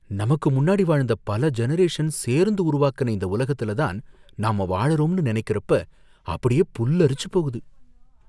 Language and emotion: Tamil, fearful